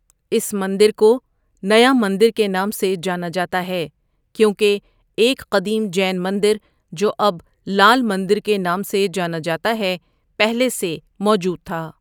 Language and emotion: Urdu, neutral